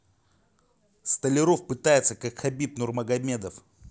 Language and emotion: Russian, angry